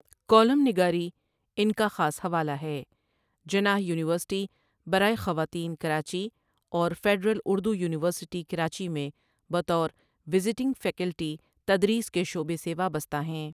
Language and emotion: Urdu, neutral